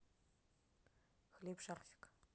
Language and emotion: Russian, neutral